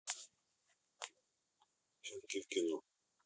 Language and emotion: Russian, neutral